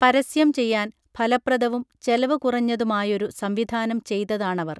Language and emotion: Malayalam, neutral